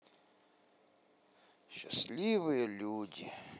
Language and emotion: Russian, sad